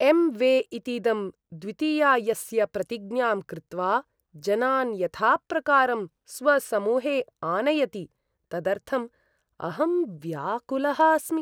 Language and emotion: Sanskrit, disgusted